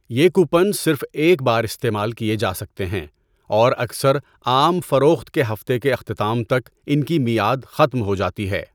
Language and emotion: Urdu, neutral